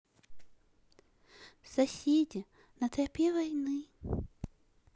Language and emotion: Russian, neutral